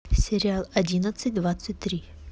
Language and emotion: Russian, neutral